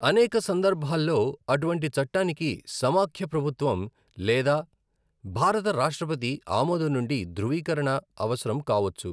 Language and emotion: Telugu, neutral